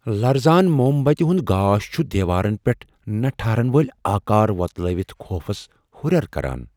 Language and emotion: Kashmiri, fearful